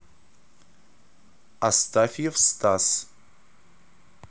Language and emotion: Russian, neutral